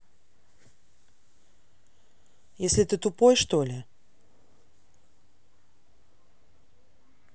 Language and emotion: Russian, angry